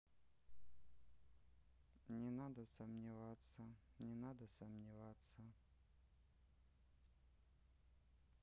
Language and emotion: Russian, neutral